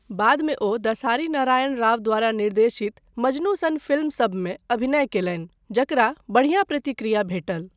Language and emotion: Maithili, neutral